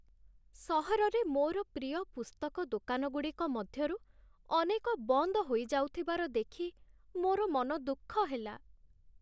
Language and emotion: Odia, sad